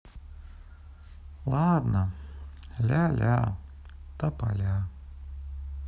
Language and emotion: Russian, sad